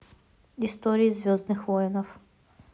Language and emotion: Russian, neutral